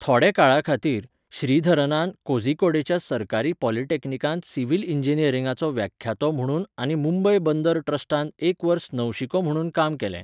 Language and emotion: Goan Konkani, neutral